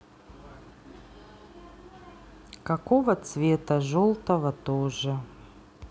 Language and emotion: Russian, neutral